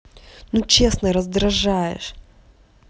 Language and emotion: Russian, angry